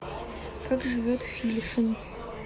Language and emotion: Russian, neutral